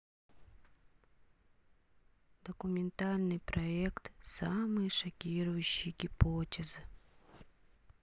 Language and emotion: Russian, sad